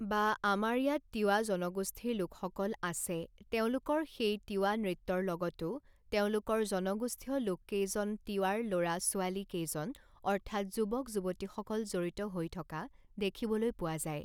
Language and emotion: Assamese, neutral